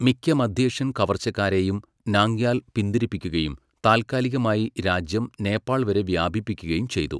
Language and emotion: Malayalam, neutral